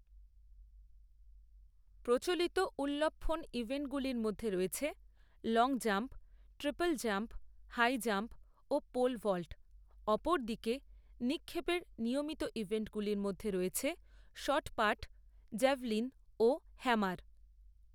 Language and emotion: Bengali, neutral